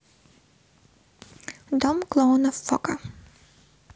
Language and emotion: Russian, neutral